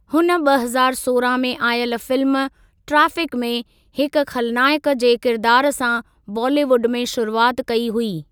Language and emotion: Sindhi, neutral